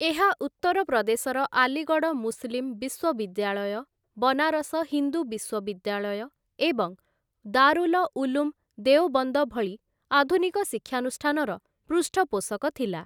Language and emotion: Odia, neutral